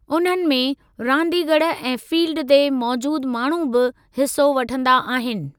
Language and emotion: Sindhi, neutral